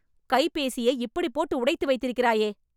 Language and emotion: Tamil, angry